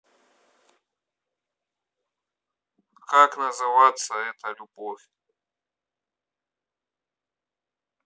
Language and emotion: Russian, neutral